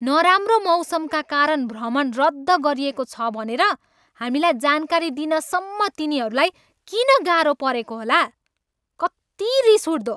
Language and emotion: Nepali, angry